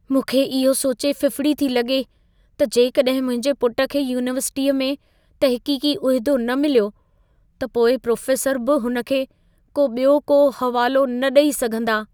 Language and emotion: Sindhi, fearful